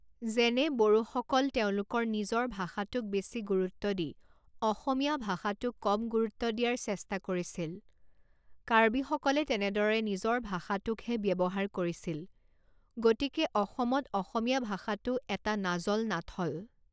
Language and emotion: Assamese, neutral